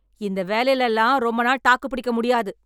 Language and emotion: Tamil, angry